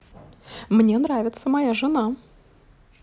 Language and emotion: Russian, positive